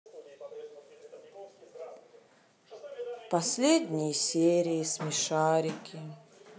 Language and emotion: Russian, sad